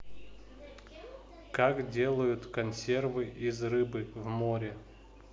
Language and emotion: Russian, neutral